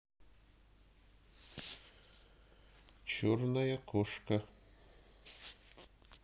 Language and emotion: Russian, neutral